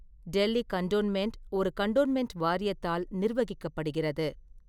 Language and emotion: Tamil, neutral